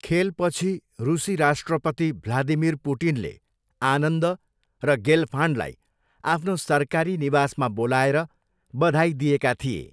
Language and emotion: Nepali, neutral